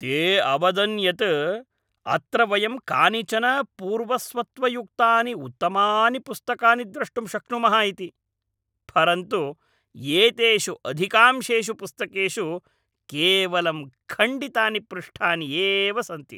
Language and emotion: Sanskrit, angry